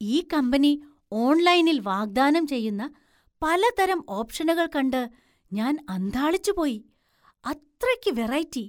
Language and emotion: Malayalam, surprised